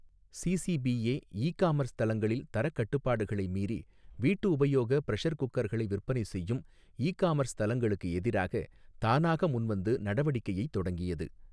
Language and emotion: Tamil, neutral